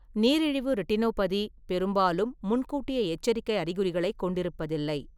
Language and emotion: Tamil, neutral